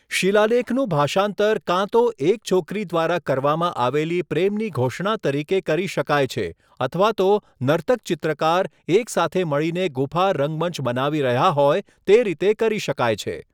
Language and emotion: Gujarati, neutral